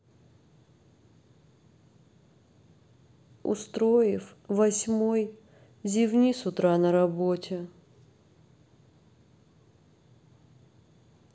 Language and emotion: Russian, sad